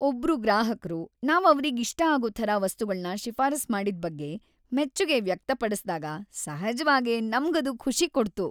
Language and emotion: Kannada, happy